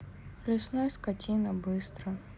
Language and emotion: Russian, sad